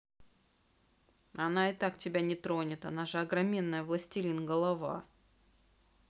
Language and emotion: Russian, neutral